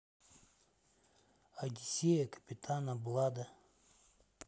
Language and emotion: Russian, neutral